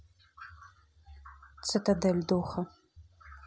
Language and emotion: Russian, neutral